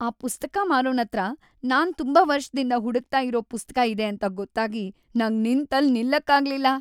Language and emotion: Kannada, happy